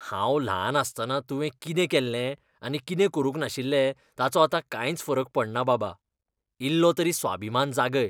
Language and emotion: Goan Konkani, disgusted